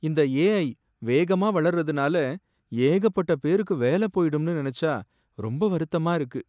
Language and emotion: Tamil, sad